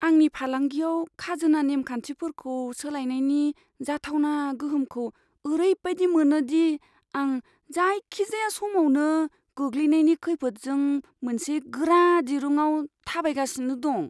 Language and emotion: Bodo, fearful